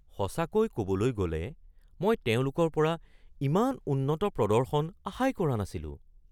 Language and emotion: Assamese, surprised